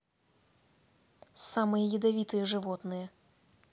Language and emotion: Russian, neutral